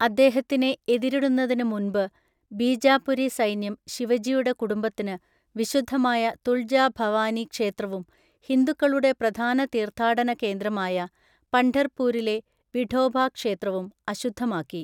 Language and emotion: Malayalam, neutral